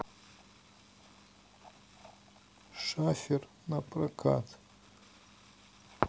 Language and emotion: Russian, neutral